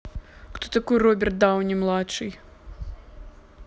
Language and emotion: Russian, neutral